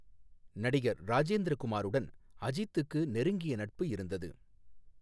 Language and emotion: Tamil, neutral